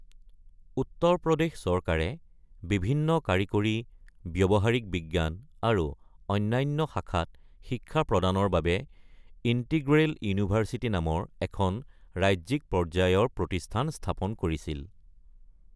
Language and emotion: Assamese, neutral